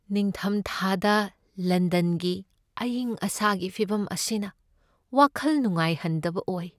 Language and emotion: Manipuri, sad